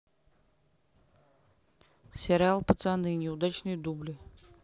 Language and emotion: Russian, neutral